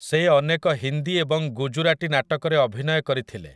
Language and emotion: Odia, neutral